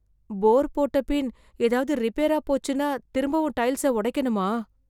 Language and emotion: Tamil, fearful